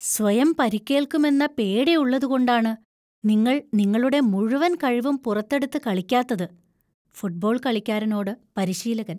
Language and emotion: Malayalam, fearful